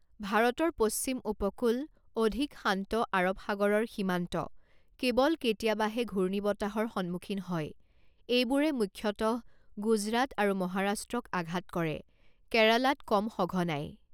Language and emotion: Assamese, neutral